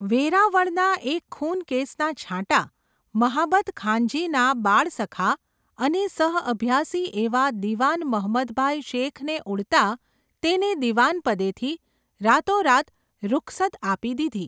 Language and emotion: Gujarati, neutral